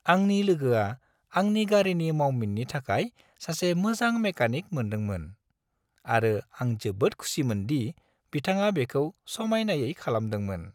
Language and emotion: Bodo, happy